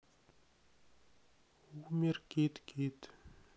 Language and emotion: Russian, sad